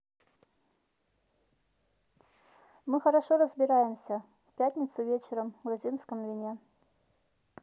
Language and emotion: Russian, neutral